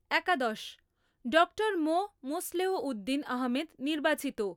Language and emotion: Bengali, neutral